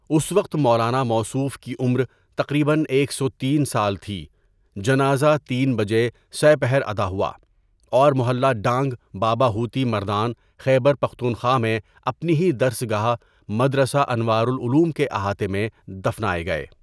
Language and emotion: Urdu, neutral